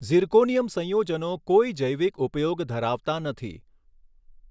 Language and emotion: Gujarati, neutral